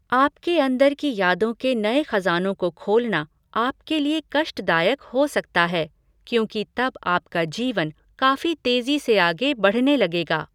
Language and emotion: Hindi, neutral